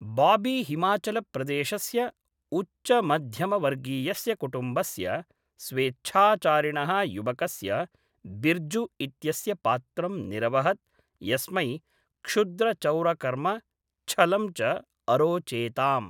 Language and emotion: Sanskrit, neutral